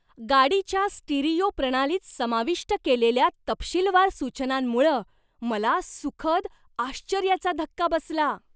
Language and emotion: Marathi, surprised